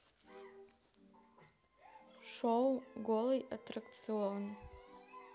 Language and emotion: Russian, neutral